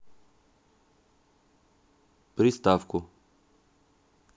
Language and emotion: Russian, neutral